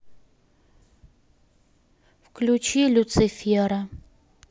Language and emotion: Russian, neutral